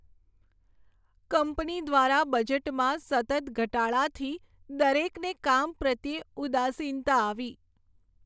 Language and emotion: Gujarati, sad